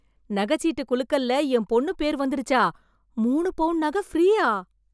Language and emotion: Tamil, surprised